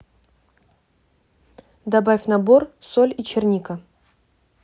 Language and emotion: Russian, neutral